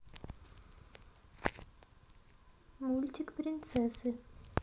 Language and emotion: Russian, neutral